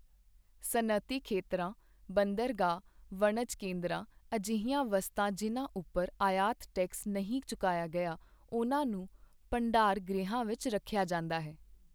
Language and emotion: Punjabi, neutral